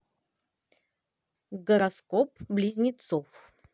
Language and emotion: Russian, positive